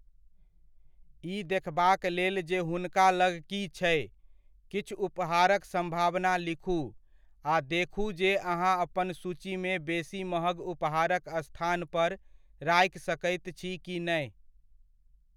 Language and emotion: Maithili, neutral